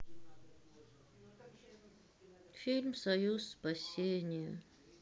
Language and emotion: Russian, sad